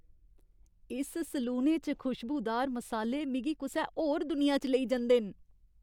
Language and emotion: Dogri, happy